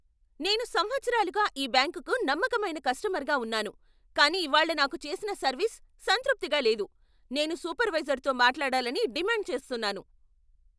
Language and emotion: Telugu, angry